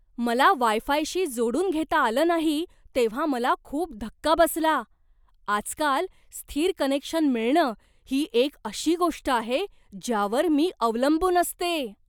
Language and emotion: Marathi, surprised